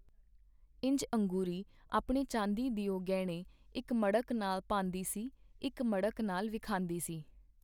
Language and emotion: Punjabi, neutral